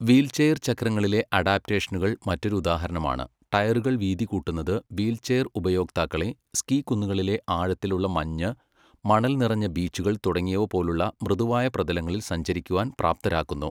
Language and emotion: Malayalam, neutral